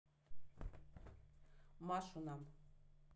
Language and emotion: Russian, neutral